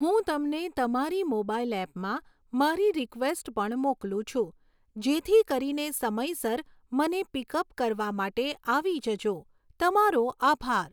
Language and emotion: Gujarati, neutral